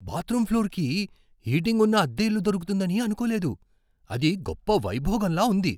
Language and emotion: Telugu, surprised